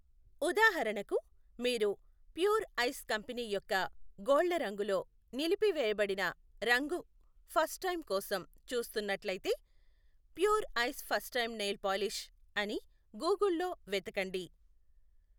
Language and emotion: Telugu, neutral